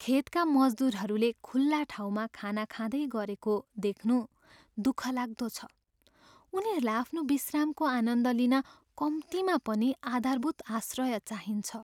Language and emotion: Nepali, sad